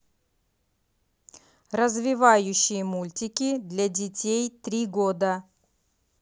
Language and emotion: Russian, neutral